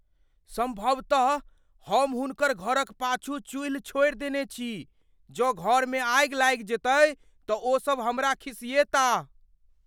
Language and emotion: Maithili, fearful